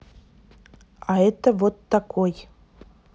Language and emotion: Russian, neutral